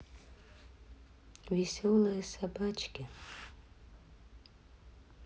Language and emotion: Russian, sad